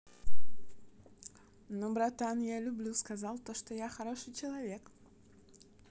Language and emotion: Russian, positive